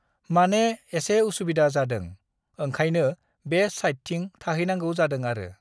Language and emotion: Bodo, neutral